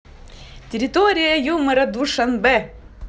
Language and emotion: Russian, positive